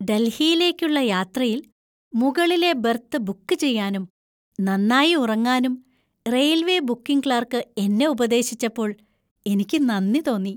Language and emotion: Malayalam, happy